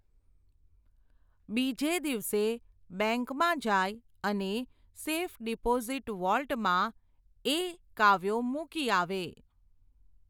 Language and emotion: Gujarati, neutral